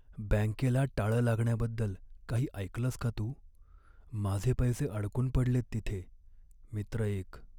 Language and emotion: Marathi, sad